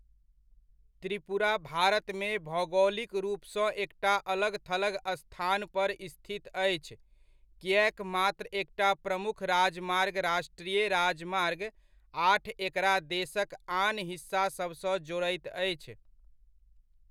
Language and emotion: Maithili, neutral